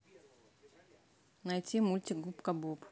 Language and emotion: Russian, neutral